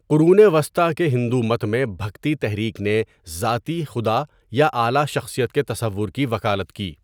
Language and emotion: Urdu, neutral